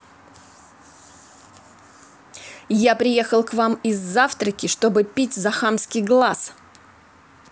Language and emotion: Russian, angry